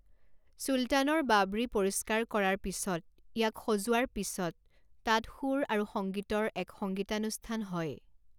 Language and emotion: Assamese, neutral